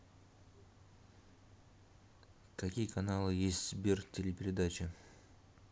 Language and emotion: Russian, neutral